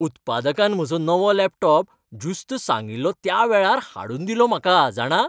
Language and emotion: Goan Konkani, happy